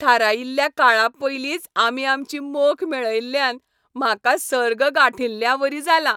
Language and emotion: Goan Konkani, happy